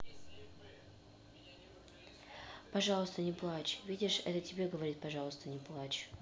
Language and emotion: Russian, neutral